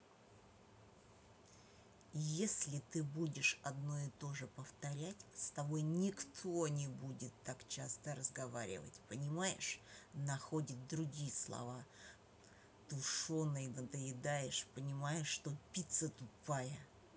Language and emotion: Russian, angry